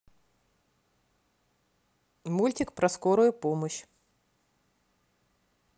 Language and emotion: Russian, neutral